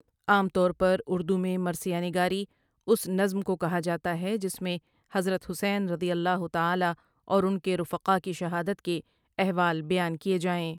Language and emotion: Urdu, neutral